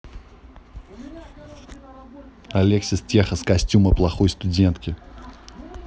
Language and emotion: Russian, neutral